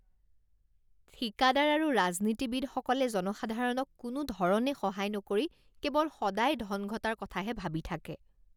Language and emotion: Assamese, disgusted